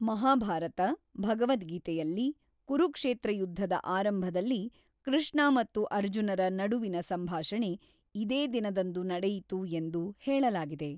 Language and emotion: Kannada, neutral